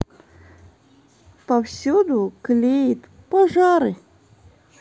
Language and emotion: Russian, neutral